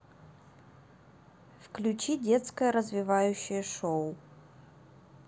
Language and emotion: Russian, neutral